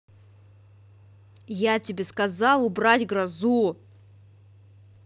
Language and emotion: Russian, angry